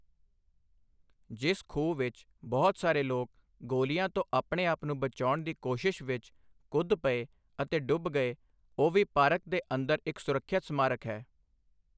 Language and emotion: Punjabi, neutral